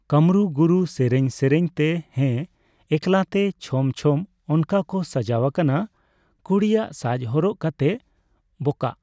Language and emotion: Santali, neutral